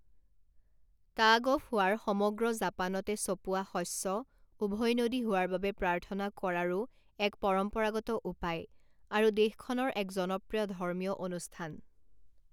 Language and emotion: Assamese, neutral